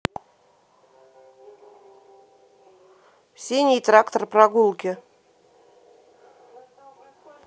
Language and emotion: Russian, neutral